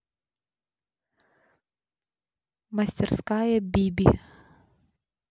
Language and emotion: Russian, neutral